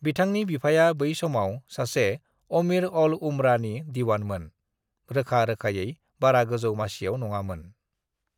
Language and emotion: Bodo, neutral